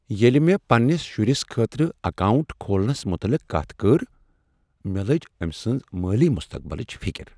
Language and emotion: Kashmiri, sad